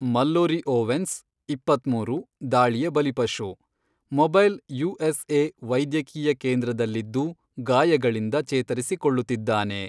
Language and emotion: Kannada, neutral